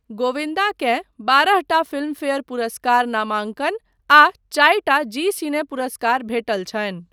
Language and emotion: Maithili, neutral